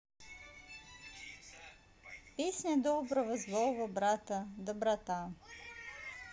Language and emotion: Russian, neutral